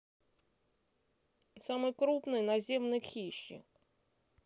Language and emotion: Russian, neutral